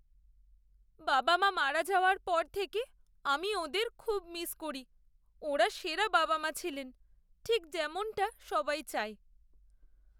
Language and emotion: Bengali, sad